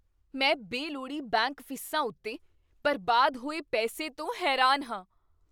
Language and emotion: Punjabi, surprised